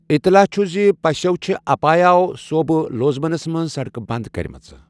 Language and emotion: Kashmiri, neutral